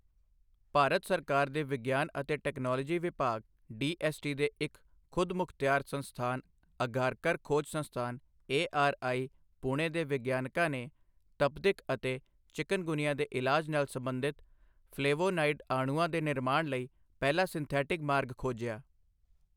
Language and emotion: Punjabi, neutral